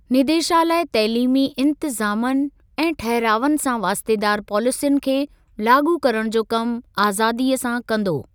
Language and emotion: Sindhi, neutral